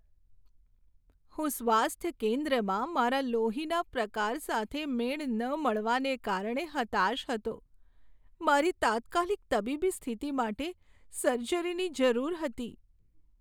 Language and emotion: Gujarati, sad